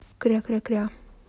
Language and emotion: Russian, neutral